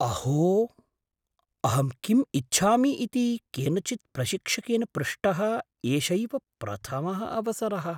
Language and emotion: Sanskrit, surprised